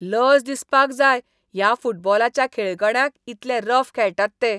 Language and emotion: Goan Konkani, disgusted